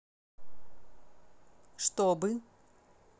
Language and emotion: Russian, neutral